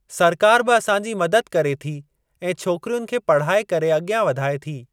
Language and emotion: Sindhi, neutral